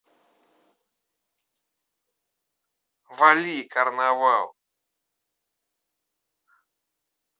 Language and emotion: Russian, angry